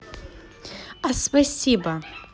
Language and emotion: Russian, positive